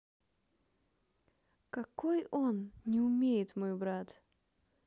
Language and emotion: Russian, sad